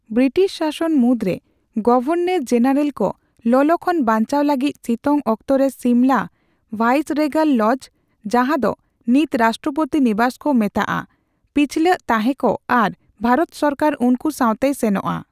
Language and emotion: Santali, neutral